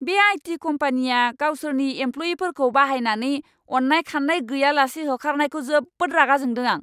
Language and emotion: Bodo, angry